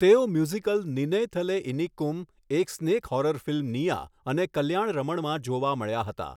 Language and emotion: Gujarati, neutral